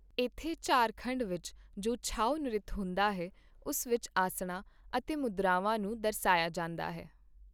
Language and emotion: Punjabi, neutral